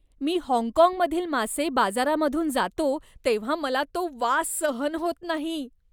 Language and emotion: Marathi, disgusted